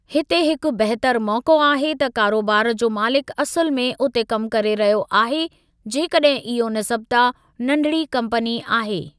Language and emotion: Sindhi, neutral